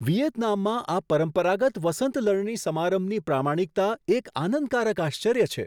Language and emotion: Gujarati, surprised